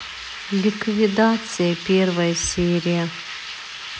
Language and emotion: Russian, sad